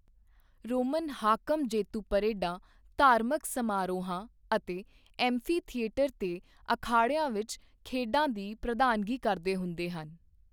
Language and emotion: Punjabi, neutral